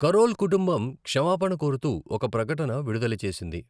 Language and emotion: Telugu, neutral